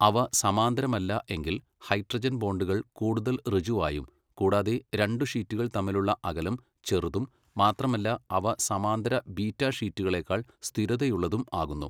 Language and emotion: Malayalam, neutral